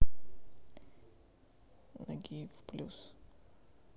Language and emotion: Russian, neutral